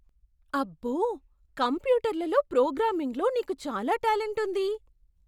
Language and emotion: Telugu, surprised